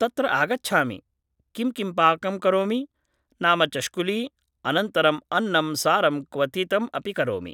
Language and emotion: Sanskrit, neutral